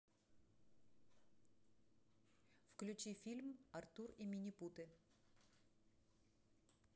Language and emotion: Russian, neutral